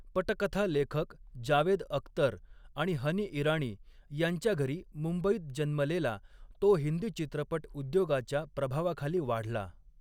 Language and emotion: Marathi, neutral